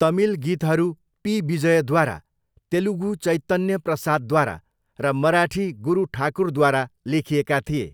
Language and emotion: Nepali, neutral